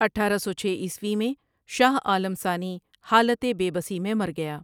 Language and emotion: Urdu, neutral